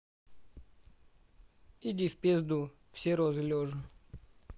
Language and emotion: Russian, neutral